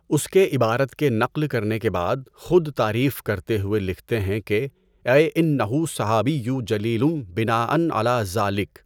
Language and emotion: Urdu, neutral